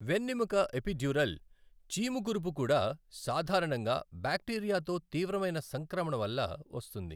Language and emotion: Telugu, neutral